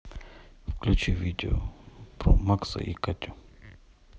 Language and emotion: Russian, neutral